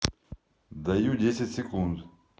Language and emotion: Russian, neutral